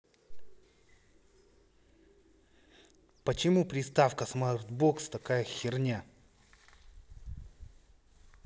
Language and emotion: Russian, angry